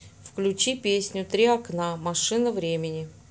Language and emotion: Russian, neutral